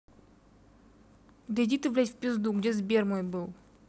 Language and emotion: Russian, neutral